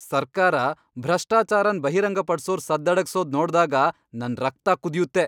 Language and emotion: Kannada, angry